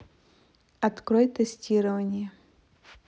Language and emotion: Russian, neutral